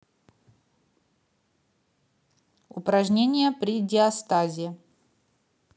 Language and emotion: Russian, neutral